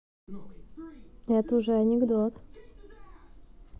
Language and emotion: Russian, neutral